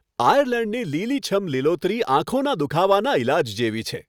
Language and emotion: Gujarati, happy